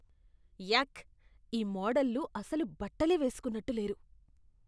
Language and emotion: Telugu, disgusted